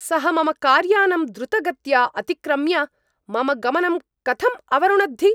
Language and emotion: Sanskrit, angry